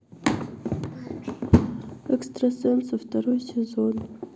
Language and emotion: Russian, sad